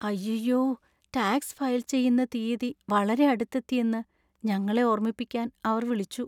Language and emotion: Malayalam, sad